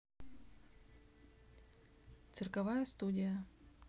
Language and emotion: Russian, neutral